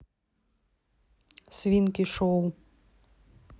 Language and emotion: Russian, neutral